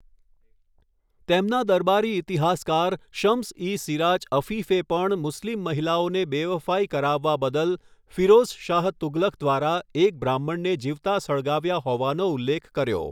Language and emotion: Gujarati, neutral